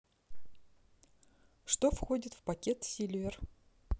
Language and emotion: Russian, neutral